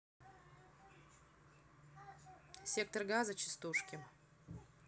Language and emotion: Russian, neutral